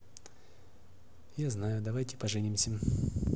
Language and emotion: Russian, neutral